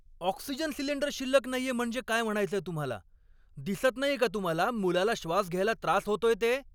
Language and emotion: Marathi, angry